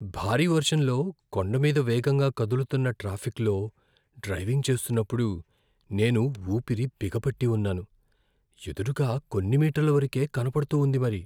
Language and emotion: Telugu, fearful